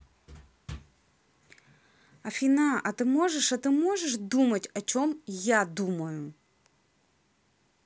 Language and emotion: Russian, angry